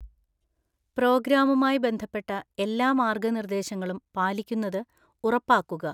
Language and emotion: Malayalam, neutral